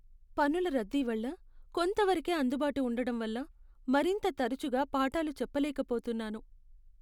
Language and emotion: Telugu, sad